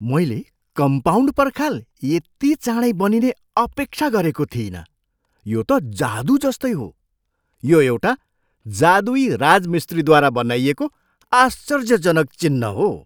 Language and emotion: Nepali, surprised